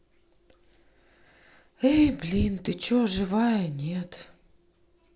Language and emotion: Russian, sad